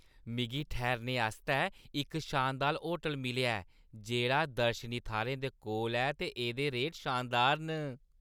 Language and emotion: Dogri, happy